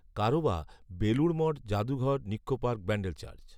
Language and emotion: Bengali, neutral